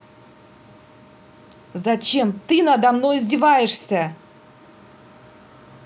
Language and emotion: Russian, angry